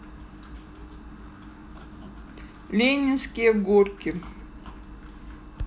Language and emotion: Russian, neutral